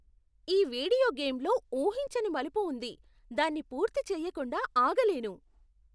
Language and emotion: Telugu, surprised